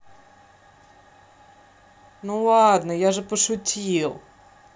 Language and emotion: Russian, neutral